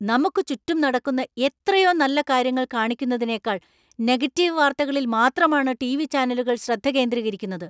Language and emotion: Malayalam, angry